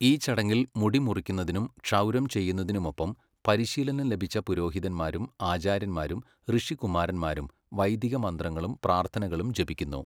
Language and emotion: Malayalam, neutral